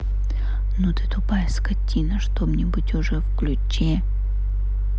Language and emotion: Russian, neutral